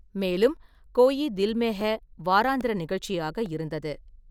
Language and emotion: Tamil, neutral